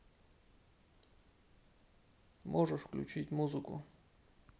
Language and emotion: Russian, neutral